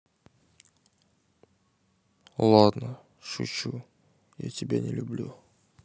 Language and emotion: Russian, sad